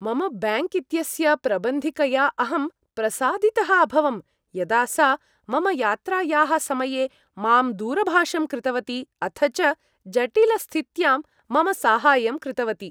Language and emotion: Sanskrit, happy